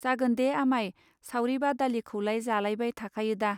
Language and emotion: Bodo, neutral